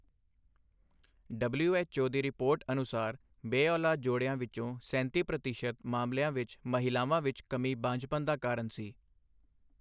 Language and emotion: Punjabi, neutral